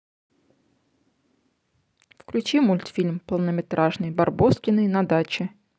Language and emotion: Russian, neutral